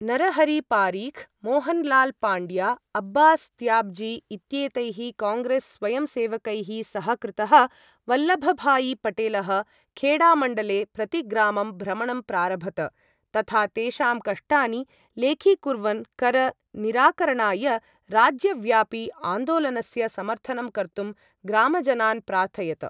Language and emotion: Sanskrit, neutral